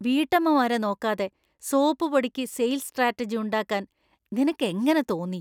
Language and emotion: Malayalam, disgusted